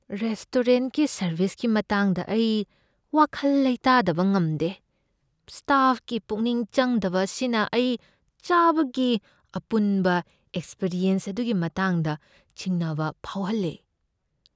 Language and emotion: Manipuri, fearful